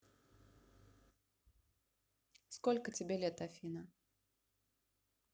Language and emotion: Russian, neutral